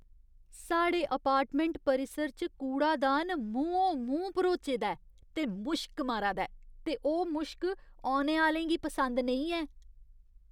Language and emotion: Dogri, disgusted